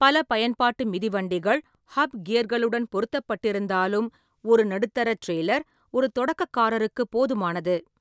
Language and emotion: Tamil, neutral